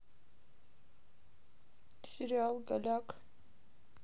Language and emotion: Russian, sad